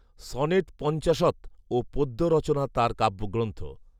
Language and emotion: Bengali, neutral